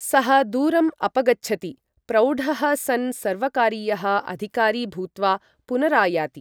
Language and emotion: Sanskrit, neutral